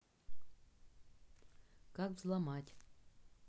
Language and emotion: Russian, neutral